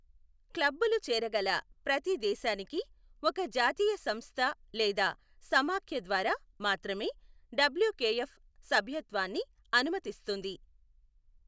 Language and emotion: Telugu, neutral